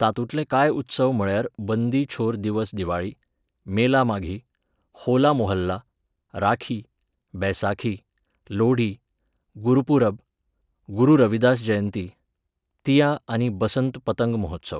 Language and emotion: Goan Konkani, neutral